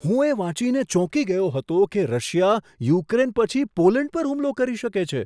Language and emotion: Gujarati, surprised